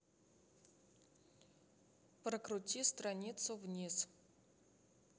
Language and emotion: Russian, neutral